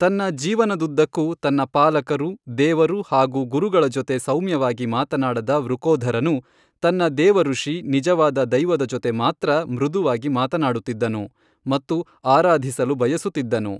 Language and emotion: Kannada, neutral